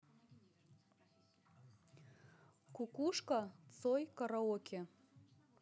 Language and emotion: Russian, neutral